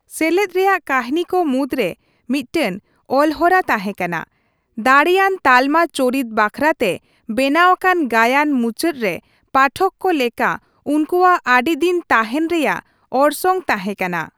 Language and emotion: Santali, neutral